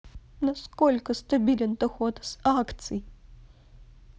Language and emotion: Russian, sad